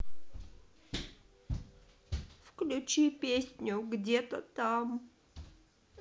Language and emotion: Russian, sad